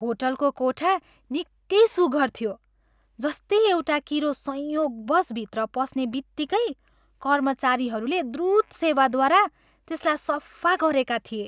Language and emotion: Nepali, happy